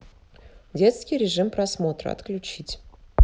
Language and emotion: Russian, neutral